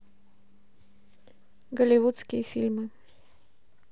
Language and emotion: Russian, neutral